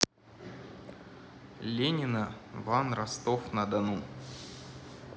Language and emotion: Russian, neutral